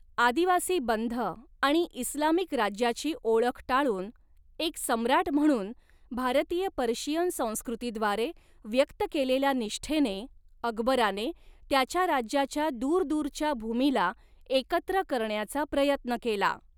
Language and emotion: Marathi, neutral